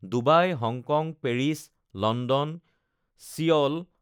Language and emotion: Assamese, neutral